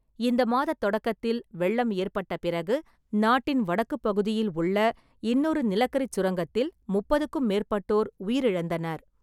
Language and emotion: Tamil, neutral